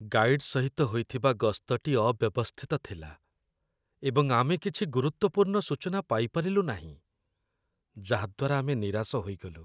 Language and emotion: Odia, sad